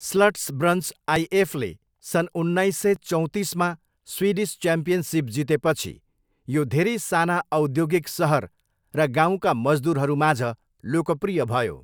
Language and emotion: Nepali, neutral